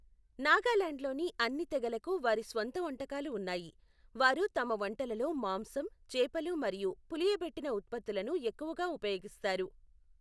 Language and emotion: Telugu, neutral